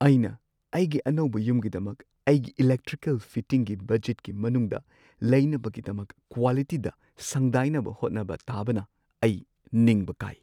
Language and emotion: Manipuri, sad